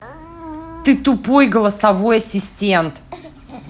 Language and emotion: Russian, angry